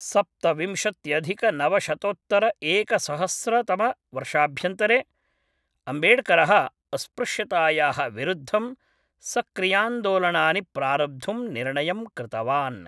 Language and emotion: Sanskrit, neutral